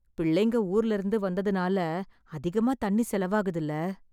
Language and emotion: Tamil, sad